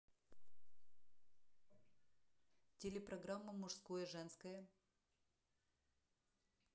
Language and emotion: Russian, neutral